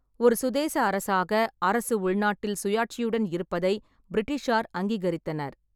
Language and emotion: Tamil, neutral